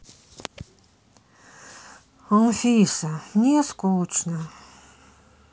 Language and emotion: Russian, sad